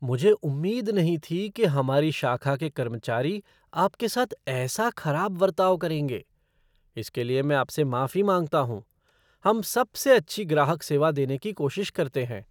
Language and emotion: Hindi, surprised